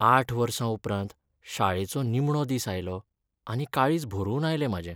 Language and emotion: Goan Konkani, sad